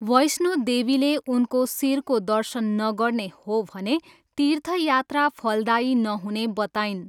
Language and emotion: Nepali, neutral